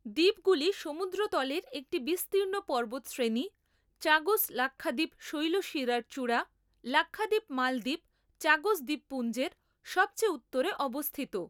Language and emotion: Bengali, neutral